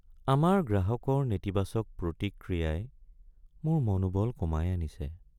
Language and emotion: Assamese, sad